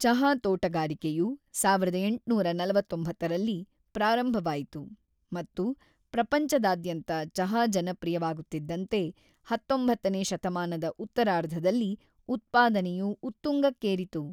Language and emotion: Kannada, neutral